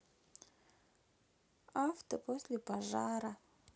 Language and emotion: Russian, sad